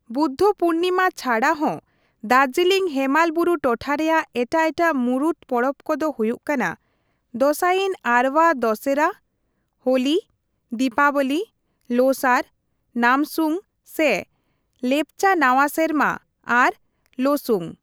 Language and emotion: Santali, neutral